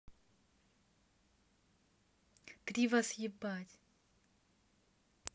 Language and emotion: Russian, neutral